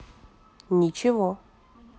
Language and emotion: Russian, neutral